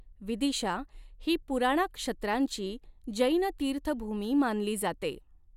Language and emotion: Marathi, neutral